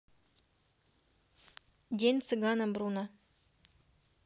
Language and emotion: Russian, neutral